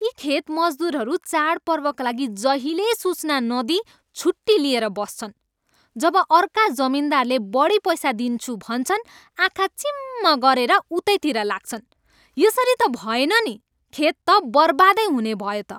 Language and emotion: Nepali, angry